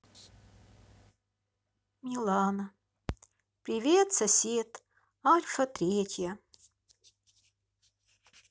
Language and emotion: Russian, sad